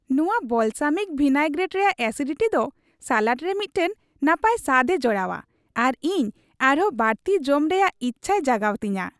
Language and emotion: Santali, happy